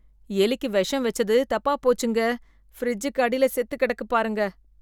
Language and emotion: Tamil, disgusted